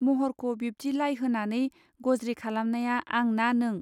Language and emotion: Bodo, neutral